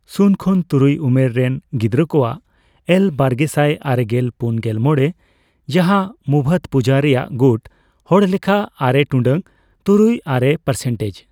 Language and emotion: Santali, neutral